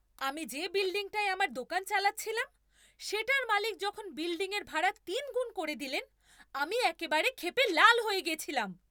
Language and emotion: Bengali, angry